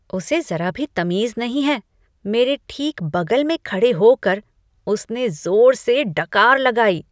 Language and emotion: Hindi, disgusted